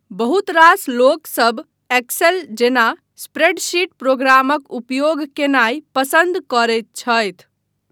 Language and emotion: Maithili, neutral